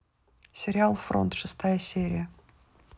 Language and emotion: Russian, neutral